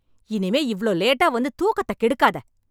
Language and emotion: Tamil, angry